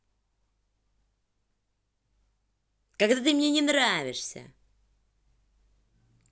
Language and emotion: Russian, angry